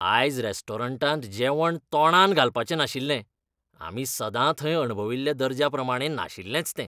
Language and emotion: Goan Konkani, disgusted